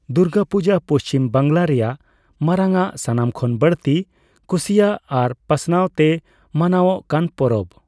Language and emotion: Santali, neutral